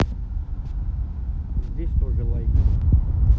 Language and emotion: Russian, neutral